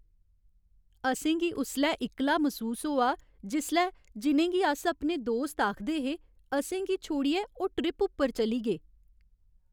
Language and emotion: Dogri, sad